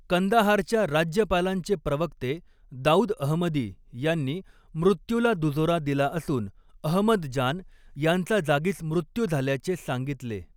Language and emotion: Marathi, neutral